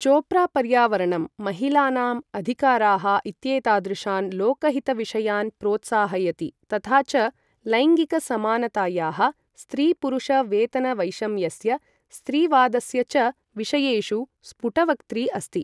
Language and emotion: Sanskrit, neutral